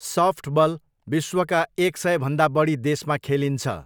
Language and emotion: Nepali, neutral